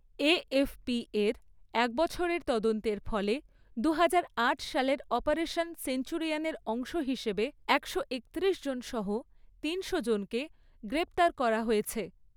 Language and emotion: Bengali, neutral